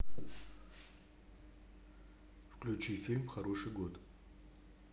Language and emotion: Russian, neutral